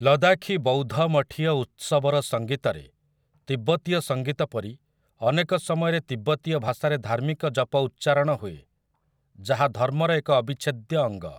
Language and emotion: Odia, neutral